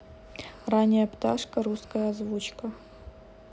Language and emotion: Russian, neutral